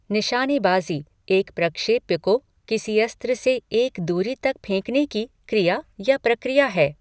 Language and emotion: Hindi, neutral